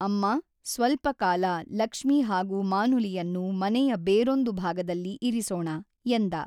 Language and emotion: Kannada, neutral